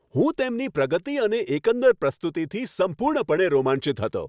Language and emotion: Gujarati, happy